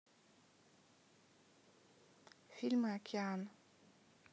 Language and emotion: Russian, neutral